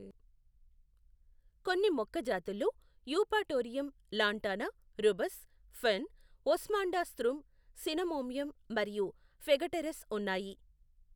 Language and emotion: Telugu, neutral